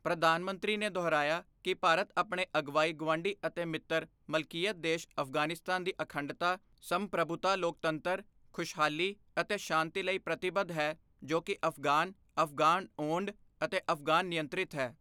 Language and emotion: Punjabi, neutral